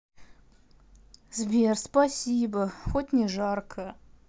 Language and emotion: Russian, sad